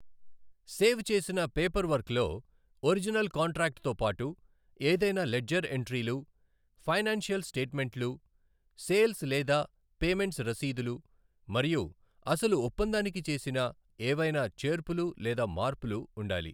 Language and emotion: Telugu, neutral